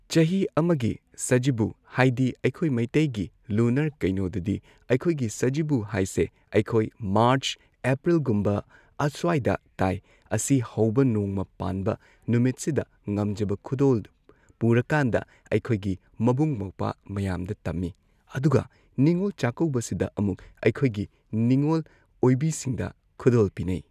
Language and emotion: Manipuri, neutral